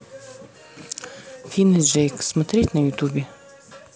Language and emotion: Russian, neutral